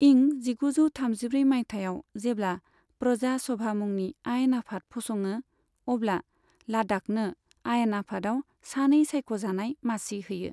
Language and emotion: Bodo, neutral